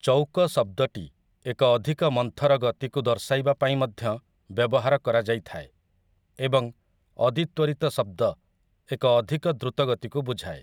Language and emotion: Odia, neutral